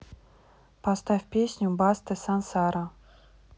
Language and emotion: Russian, neutral